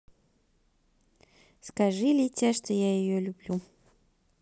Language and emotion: Russian, neutral